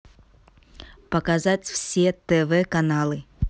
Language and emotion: Russian, neutral